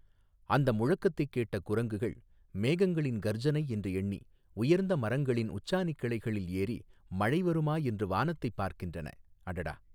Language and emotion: Tamil, neutral